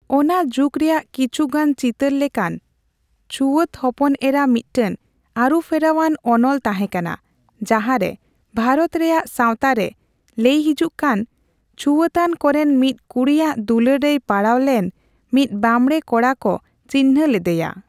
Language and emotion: Santali, neutral